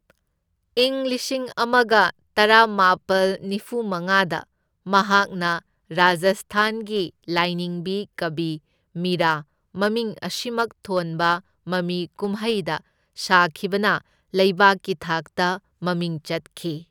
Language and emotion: Manipuri, neutral